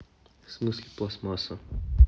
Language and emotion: Russian, neutral